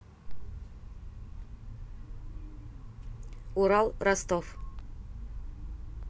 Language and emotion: Russian, neutral